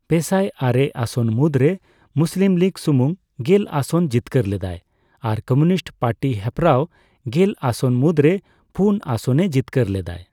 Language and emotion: Santali, neutral